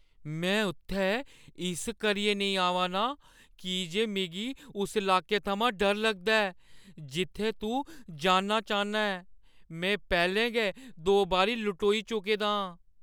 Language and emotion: Dogri, fearful